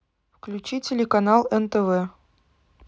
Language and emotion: Russian, neutral